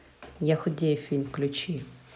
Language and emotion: Russian, neutral